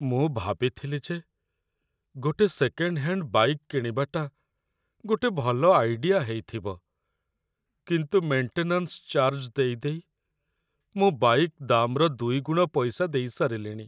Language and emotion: Odia, sad